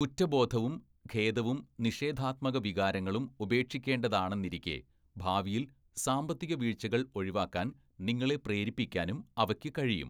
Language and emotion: Malayalam, neutral